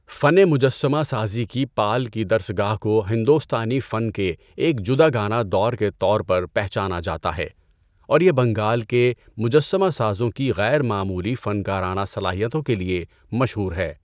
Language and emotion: Urdu, neutral